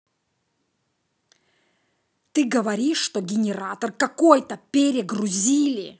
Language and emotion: Russian, angry